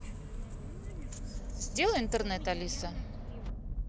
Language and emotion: Russian, neutral